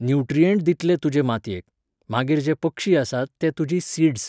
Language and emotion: Goan Konkani, neutral